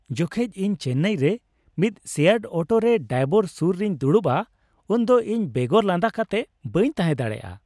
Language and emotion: Santali, happy